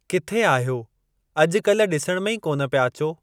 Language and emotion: Sindhi, neutral